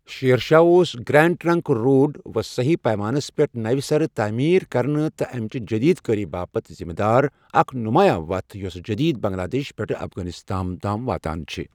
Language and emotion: Kashmiri, neutral